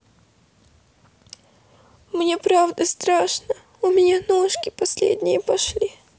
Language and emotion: Russian, sad